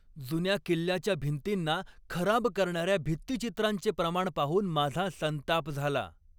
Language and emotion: Marathi, angry